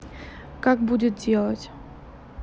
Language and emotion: Russian, neutral